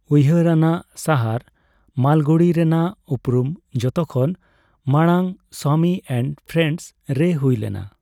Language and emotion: Santali, neutral